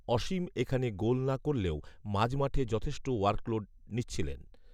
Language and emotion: Bengali, neutral